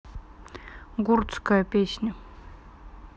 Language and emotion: Russian, neutral